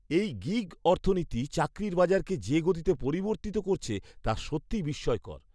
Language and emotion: Bengali, surprised